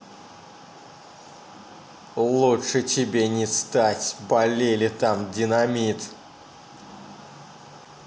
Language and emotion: Russian, angry